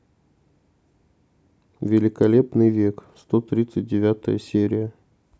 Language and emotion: Russian, neutral